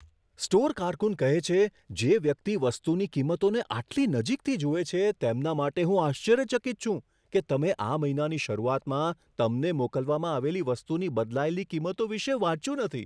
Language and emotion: Gujarati, surprised